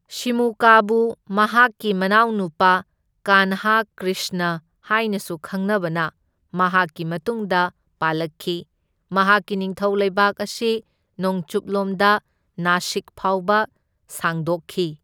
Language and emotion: Manipuri, neutral